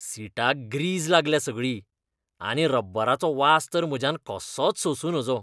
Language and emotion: Goan Konkani, disgusted